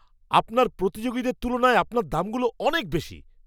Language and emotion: Bengali, angry